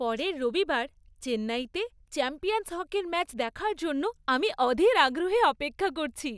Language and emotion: Bengali, happy